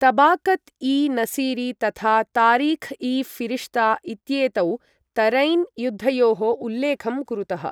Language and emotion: Sanskrit, neutral